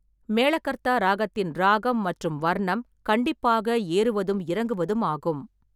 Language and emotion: Tamil, neutral